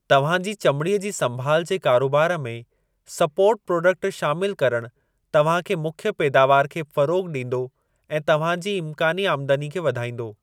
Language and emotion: Sindhi, neutral